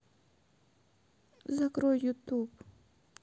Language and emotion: Russian, sad